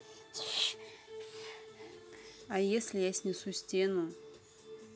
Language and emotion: Russian, neutral